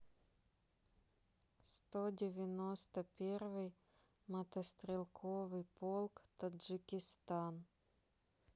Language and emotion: Russian, neutral